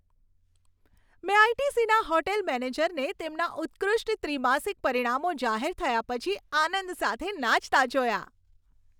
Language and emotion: Gujarati, happy